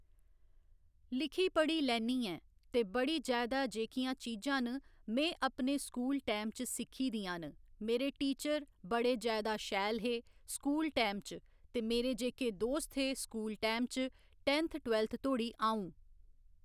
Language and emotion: Dogri, neutral